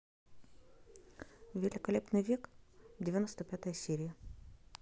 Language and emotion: Russian, neutral